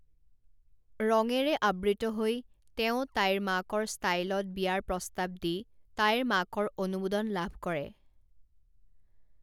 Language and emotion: Assamese, neutral